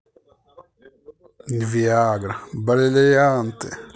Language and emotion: Russian, positive